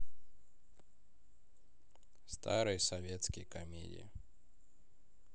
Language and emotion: Russian, neutral